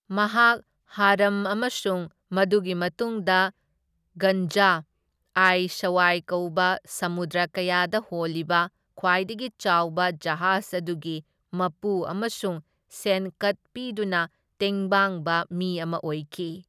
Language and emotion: Manipuri, neutral